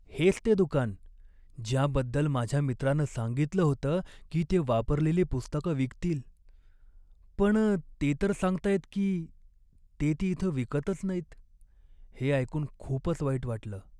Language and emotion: Marathi, sad